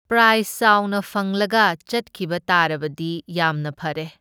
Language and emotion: Manipuri, neutral